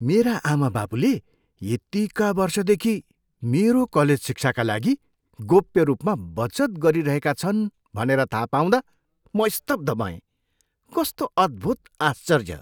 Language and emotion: Nepali, surprised